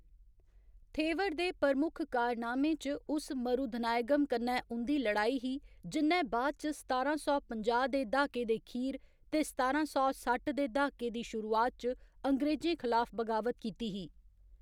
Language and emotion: Dogri, neutral